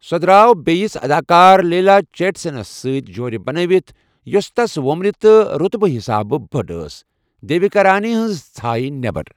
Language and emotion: Kashmiri, neutral